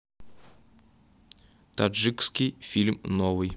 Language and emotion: Russian, neutral